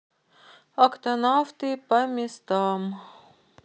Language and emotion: Russian, neutral